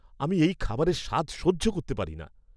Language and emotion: Bengali, disgusted